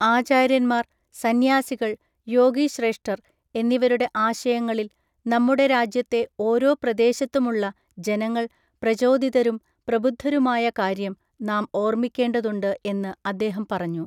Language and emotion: Malayalam, neutral